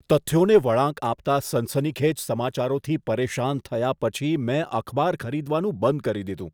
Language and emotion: Gujarati, disgusted